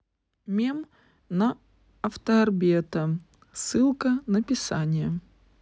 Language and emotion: Russian, neutral